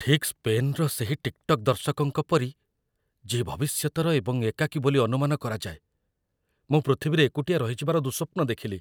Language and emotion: Odia, fearful